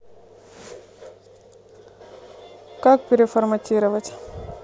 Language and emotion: Russian, neutral